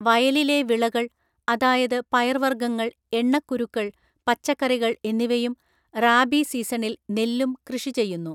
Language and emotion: Malayalam, neutral